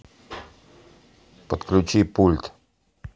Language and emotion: Russian, neutral